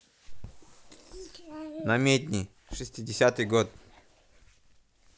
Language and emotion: Russian, neutral